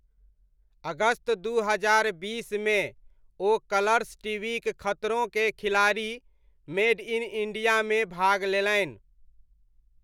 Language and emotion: Maithili, neutral